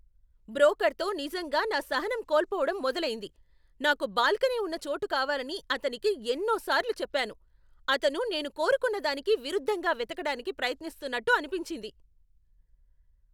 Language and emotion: Telugu, angry